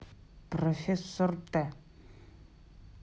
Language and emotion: Russian, neutral